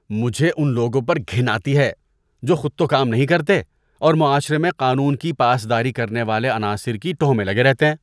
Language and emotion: Urdu, disgusted